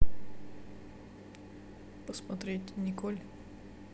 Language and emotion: Russian, neutral